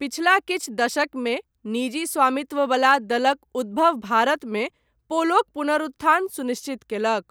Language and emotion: Maithili, neutral